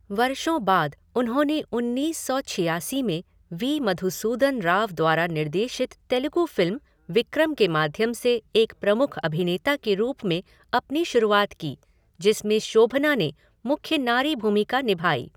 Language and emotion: Hindi, neutral